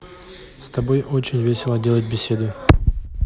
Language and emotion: Russian, neutral